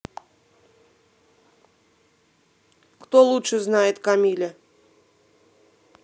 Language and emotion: Russian, neutral